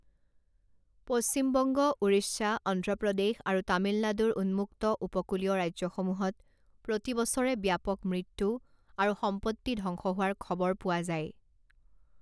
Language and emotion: Assamese, neutral